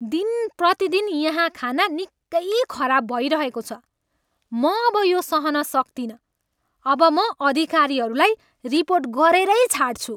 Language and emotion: Nepali, angry